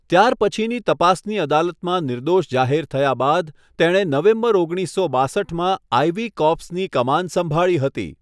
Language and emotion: Gujarati, neutral